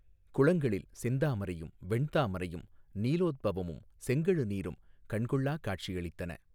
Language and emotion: Tamil, neutral